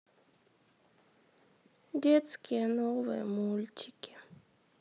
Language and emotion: Russian, sad